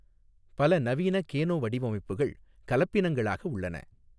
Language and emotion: Tamil, neutral